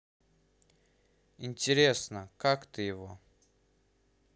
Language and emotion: Russian, neutral